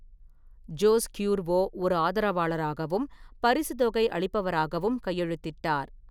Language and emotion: Tamil, neutral